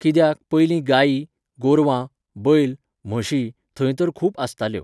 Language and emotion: Goan Konkani, neutral